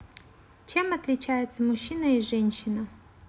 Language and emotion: Russian, neutral